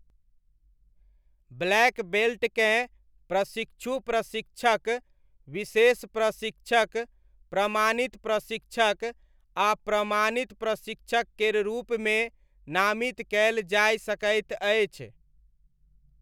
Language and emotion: Maithili, neutral